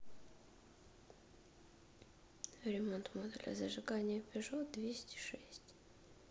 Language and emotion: Russian, neutral